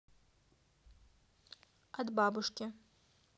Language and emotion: Russian, neutral